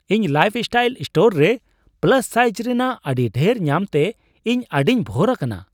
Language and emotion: Santali, surprised